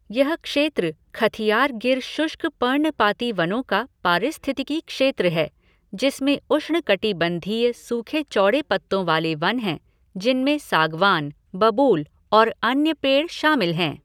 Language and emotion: Hindi, neutral